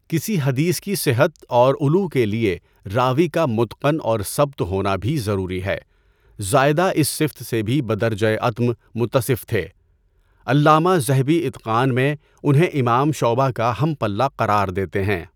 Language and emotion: Urdu, neutral